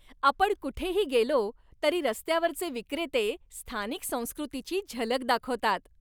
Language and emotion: Marathi, happy